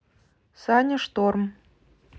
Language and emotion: Russian, neutral